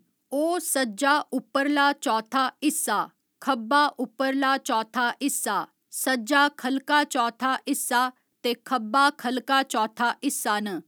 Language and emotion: Dogri, neutral